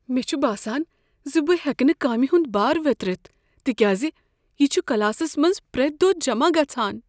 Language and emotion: Kashmiri, fearful